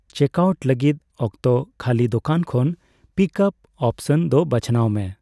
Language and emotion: Santali, neutral